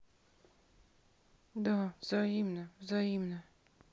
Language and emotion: Russian, sad